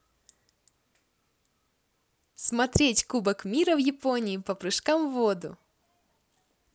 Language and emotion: Russian, positive